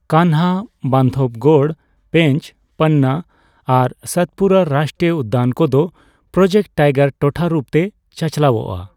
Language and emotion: Santali, neutral